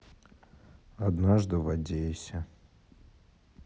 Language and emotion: Russian, sad